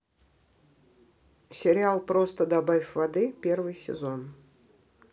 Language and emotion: Russian, neutral